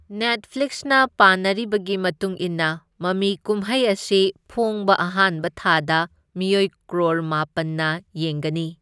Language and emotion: Manipuri, neutral